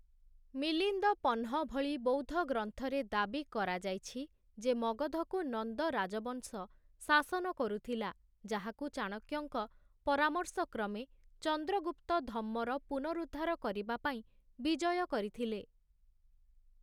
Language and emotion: Odia, neutral